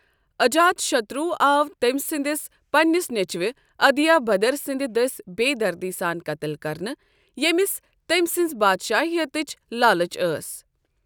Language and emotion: Kashmiri, neutral